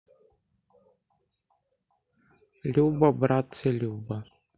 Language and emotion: Russian, sad